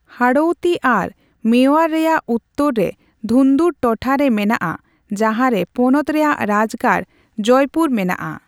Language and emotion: Santali, neutral